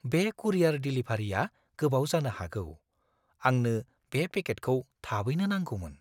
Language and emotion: Bodo, fearful